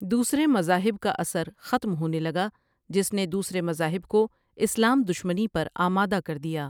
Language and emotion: Urdu, neutral